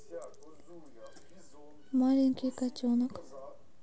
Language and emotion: Russian, neutral